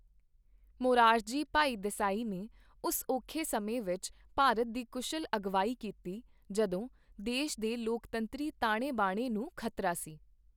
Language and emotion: Punjabi, neutral